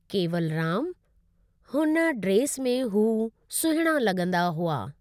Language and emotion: Sindhi, neutral